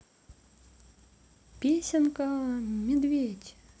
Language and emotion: Russian, positive